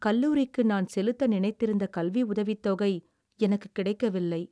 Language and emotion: Tamil, sad